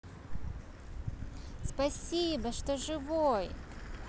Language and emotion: Russian, positive